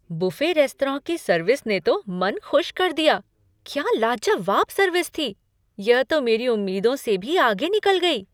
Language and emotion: Hindi, surprised